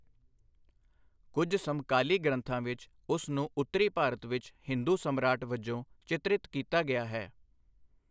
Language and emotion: Punjabi, neutral